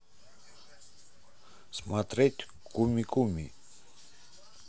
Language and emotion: Russian, neutral